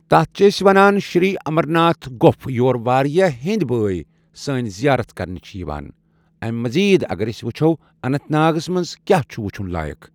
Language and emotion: Kashmiri, neutral